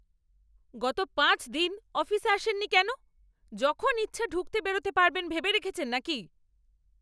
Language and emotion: Bengali, angry